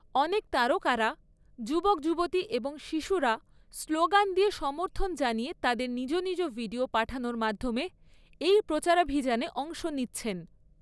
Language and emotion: Bengali, neutral